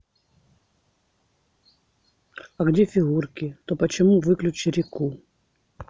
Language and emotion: Russian, neutral